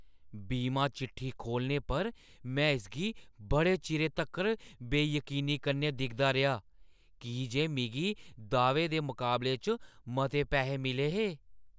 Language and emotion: Dogri, surprised